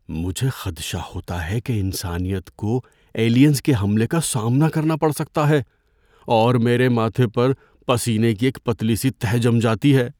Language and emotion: Urdu, fearful